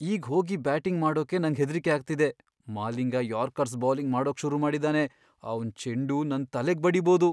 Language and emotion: Kannada, fearful